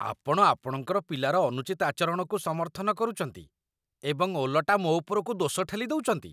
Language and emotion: Odia, disgusted